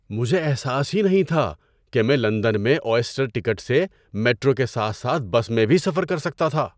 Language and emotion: Urdu, surprised